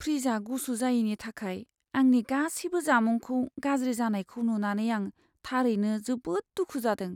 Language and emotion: Bodo, sad